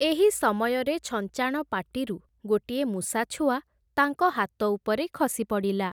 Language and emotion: Odia, neutral